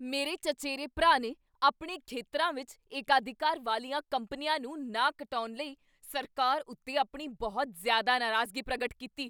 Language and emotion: Punjabi, angry